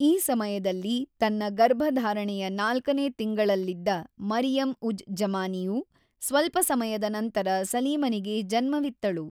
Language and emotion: Kannada, neutral